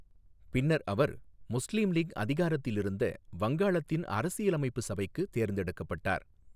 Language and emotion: Tamil, neutral